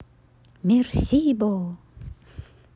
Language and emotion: Russian, positive